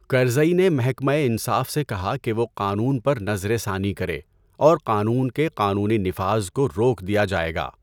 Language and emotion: Urdu, neutral